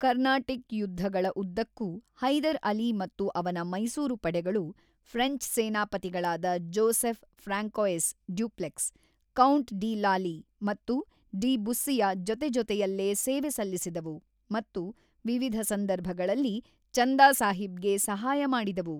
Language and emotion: Kannada, neutral